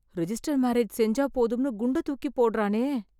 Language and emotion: Tamil, fearful